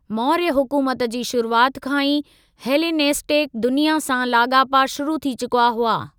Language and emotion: Sindhi, neutral